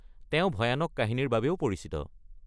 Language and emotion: Assamese, neutral